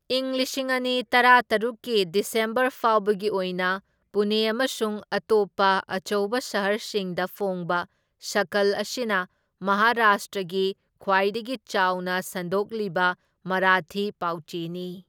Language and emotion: Manipuri, neutral